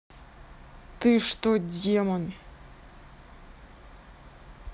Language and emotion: Russian, angry